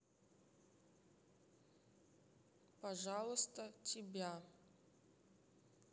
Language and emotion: Russian, neutral